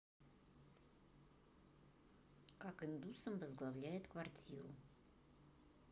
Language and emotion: Russian, neutral